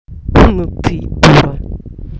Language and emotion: Russian, angry